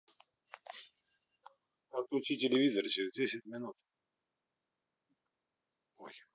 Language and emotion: Russian, neutral